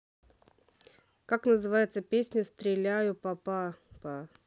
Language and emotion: Russian, neutral